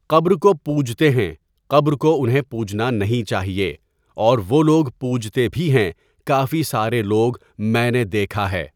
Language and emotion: Urdu, neutral